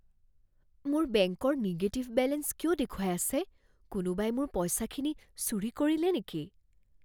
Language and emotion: Assamese, fearful